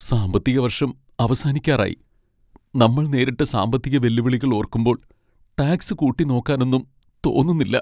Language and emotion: Malayalam, sad